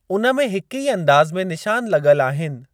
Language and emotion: Sindhi, neutral